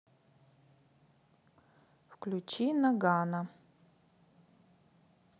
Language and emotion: Russian, neutral